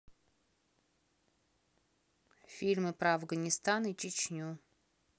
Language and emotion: Russian, neutral